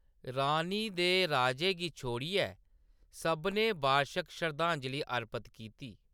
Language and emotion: Dogri, neutral